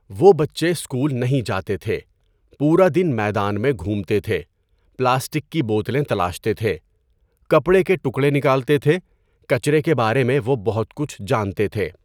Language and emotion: Urdu, neutral